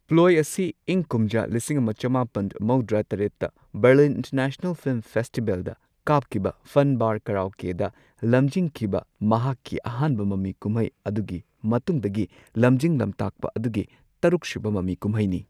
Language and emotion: Manipuri, neutral